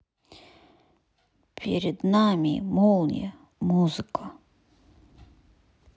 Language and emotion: Russian, sad